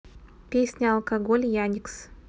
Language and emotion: Russian, neutral